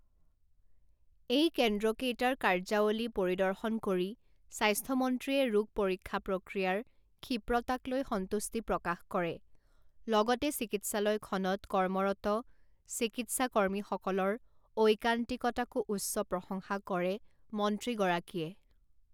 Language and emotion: Assamese, neutral